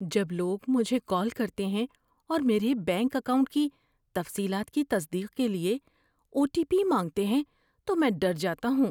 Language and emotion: Urdu, fearful